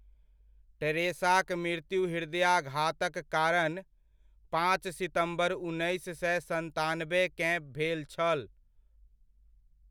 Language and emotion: Maithili, neutral